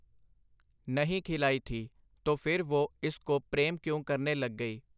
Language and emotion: Punjabi, neutral